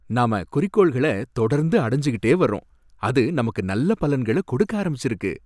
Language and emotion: Tamil, happy